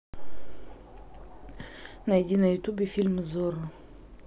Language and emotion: Russian, neutral